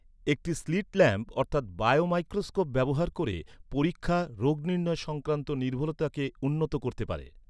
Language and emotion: Bengali, neutral